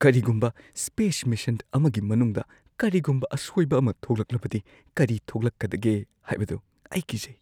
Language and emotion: Manipuri, fearful